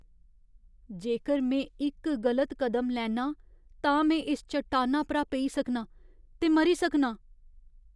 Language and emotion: Dogri, fearful